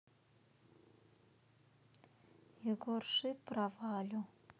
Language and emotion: Russian, sad